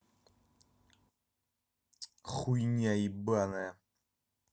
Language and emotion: Russian, angry